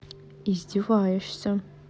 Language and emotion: Russian, neutral